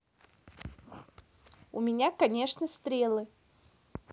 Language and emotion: Russian, neutral